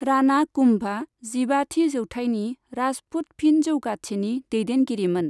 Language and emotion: Bodo, neutral